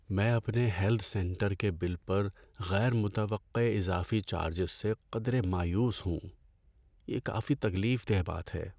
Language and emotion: Urdu, sad